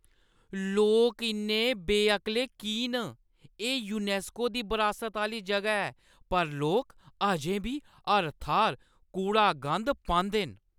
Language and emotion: Dogri, angry